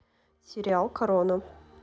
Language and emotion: Russian, neutral